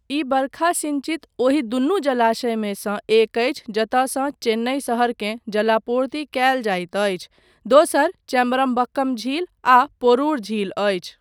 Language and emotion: Maithili, neutral